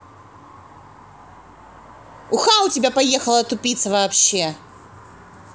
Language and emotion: Russian, angry